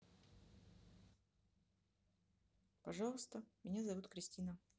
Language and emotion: Russian, neutral